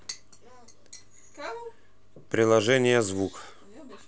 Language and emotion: Russian, neutral